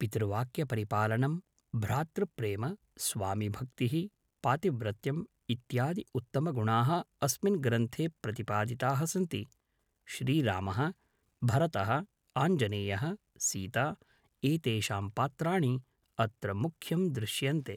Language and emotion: Sanskrit, neutral